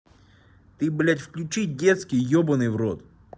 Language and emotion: Russian, angry